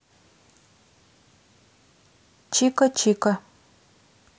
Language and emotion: Russian, neutral